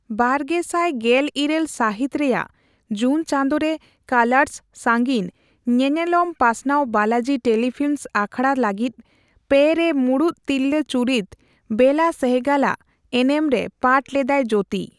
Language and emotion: Santali, neutral